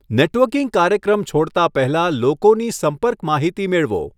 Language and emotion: Gujarati, neutral